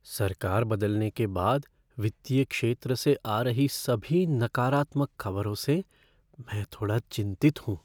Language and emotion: Hindi, fearful